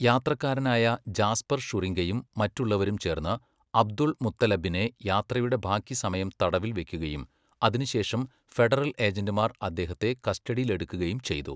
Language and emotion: Malayalam, neutral